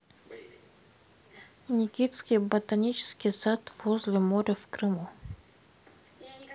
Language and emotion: Russian, neutral